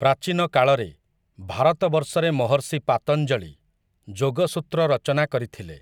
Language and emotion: Odia, neutral